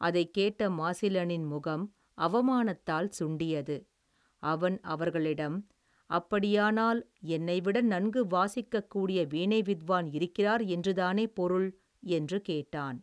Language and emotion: Tamil, neutral